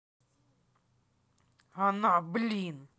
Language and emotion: Russian, angry